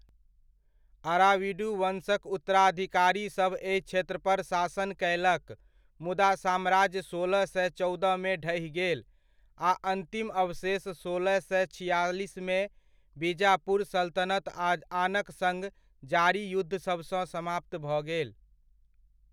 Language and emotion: Maithili, neutral